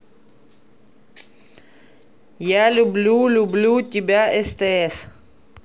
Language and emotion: Russian, neutral